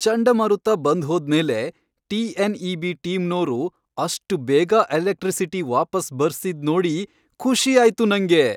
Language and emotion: Kannada, happy